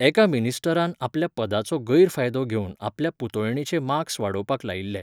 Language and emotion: Goan Konkani, neutral